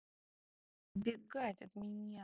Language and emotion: Russian, neutral